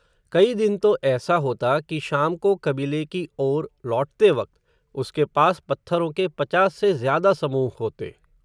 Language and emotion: Hindi, neutral